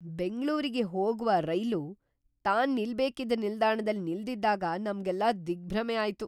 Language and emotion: Kannada, surprised